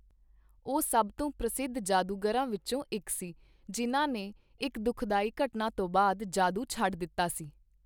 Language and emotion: Punjabi, neutral